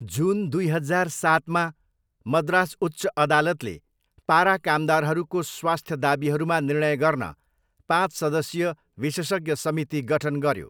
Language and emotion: Nepali, neutral